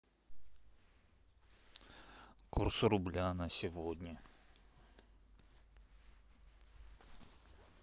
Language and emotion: Russian, neutral